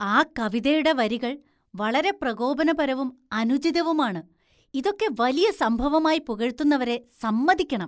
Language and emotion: Malayalam, disgusted